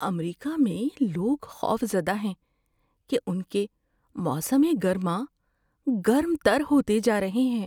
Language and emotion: Urdu, fearful